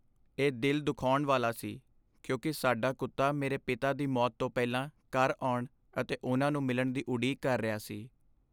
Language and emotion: Punjabi, sad